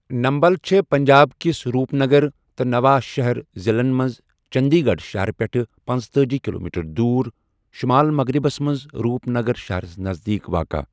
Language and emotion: Kashmiri, neutral